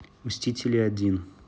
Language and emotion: Russian, neutral